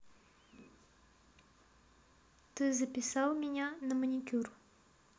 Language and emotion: Russian, neutral